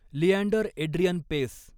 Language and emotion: Marathi, neutral